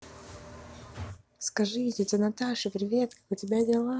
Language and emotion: Russian, positive